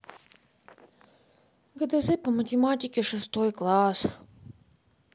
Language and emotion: Russian, sad